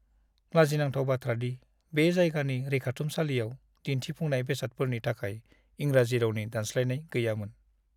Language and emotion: Bodo, sad